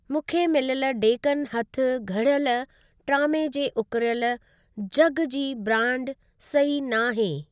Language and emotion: Sindhi, neutral